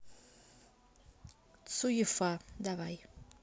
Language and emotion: Russian, neutral